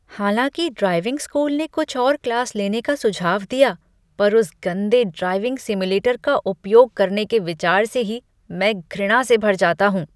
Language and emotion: Hindi, disgusted